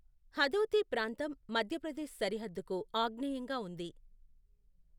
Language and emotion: Telugu, neutral